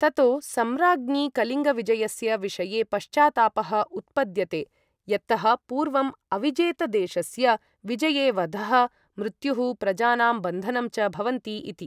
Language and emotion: Sanskrit, neutral